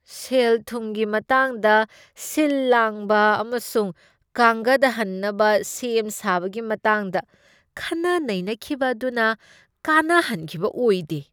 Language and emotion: Manipuri, disgusted